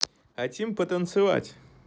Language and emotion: Russian, positive